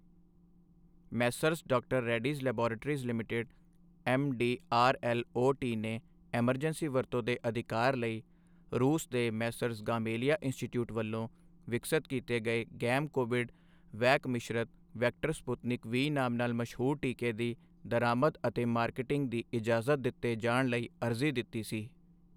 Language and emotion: Punjabi, neutral